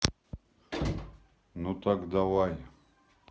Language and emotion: Russian, neutral